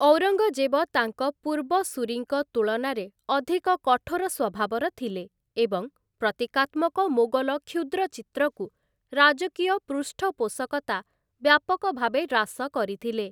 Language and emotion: Odia, neutral